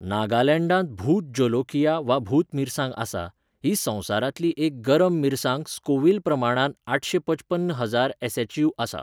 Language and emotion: Goan Konkani, neutral